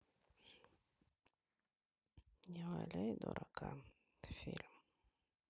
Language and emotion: Russian, sad